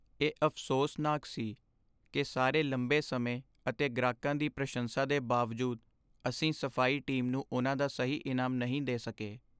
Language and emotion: Punjabi, sad